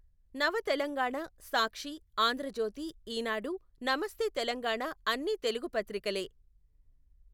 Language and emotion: Telugu, neutral